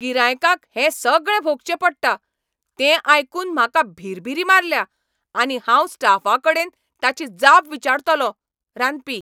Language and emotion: Goan Konkani, angry